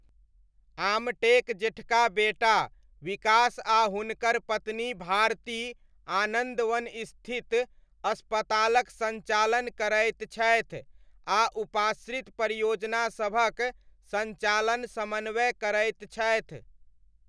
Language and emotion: Maithili, neutral